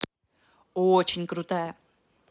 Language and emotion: Russian, positive